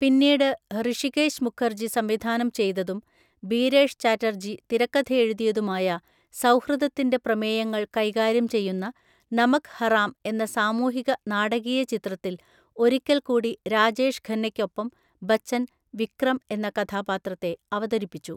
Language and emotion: Malayalam, neutral